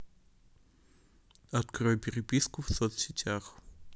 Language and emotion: Russian, neutral